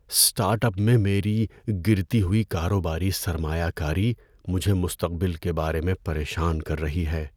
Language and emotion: Urdu, fearful